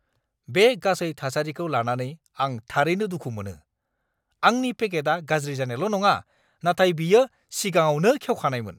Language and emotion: Bodo, angry